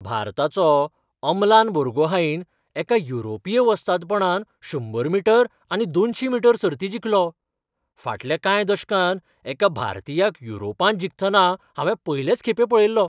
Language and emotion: Goan Konkani, surprised